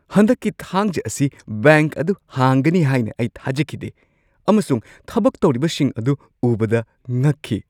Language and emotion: Manipuri, surprised